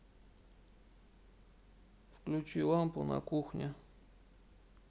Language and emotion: Russian, sad